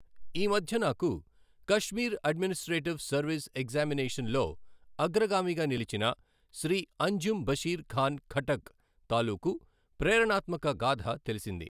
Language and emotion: Telugu, neutral